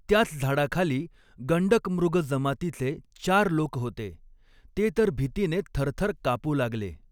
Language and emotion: Marathi, neutral